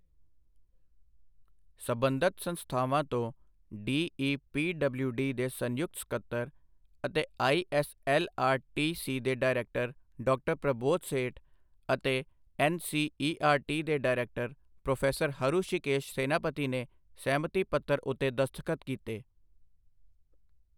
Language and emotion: Punjabi, neutral